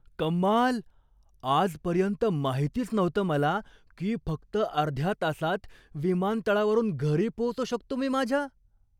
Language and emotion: Marathi, surprised